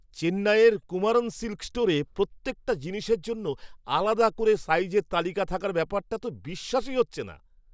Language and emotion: Bengali, surprised